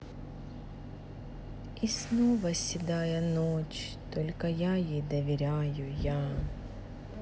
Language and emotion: Russian, sad